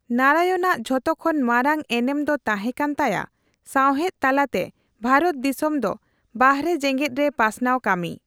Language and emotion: Santali, neutral